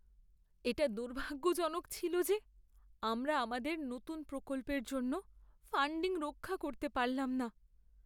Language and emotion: Bengali, sad